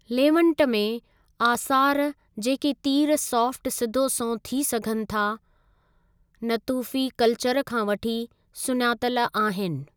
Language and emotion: Sindhi, neutral